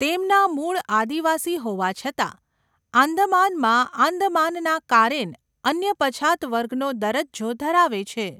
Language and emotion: Gujarati, neutral